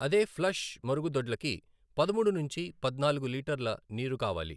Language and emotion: Telugu, neutral